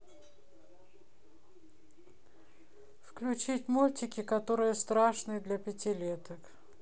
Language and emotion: Russian, neutral